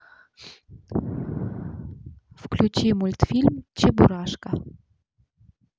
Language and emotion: Russian, neutral